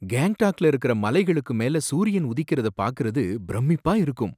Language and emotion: Tamil, surprised